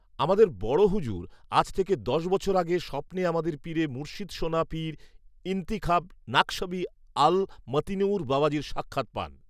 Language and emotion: Bengali, neutral